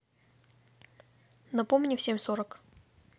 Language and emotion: Russian, neutral